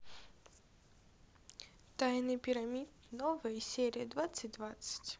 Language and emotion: Russian, sad